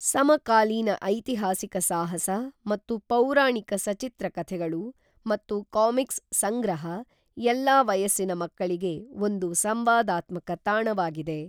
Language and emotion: Kannada, neutral